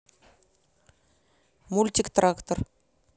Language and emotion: Russian, neutral